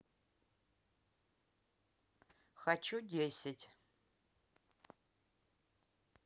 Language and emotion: Russian, neutral